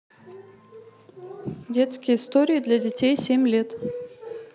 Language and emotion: Russian, neutral